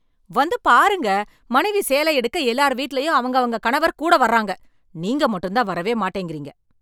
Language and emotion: Tamil, angry